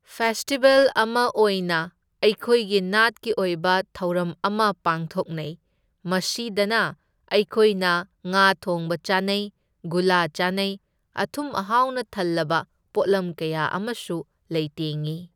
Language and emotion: Manipuri, neutral